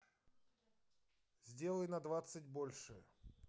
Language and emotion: Russian, neutral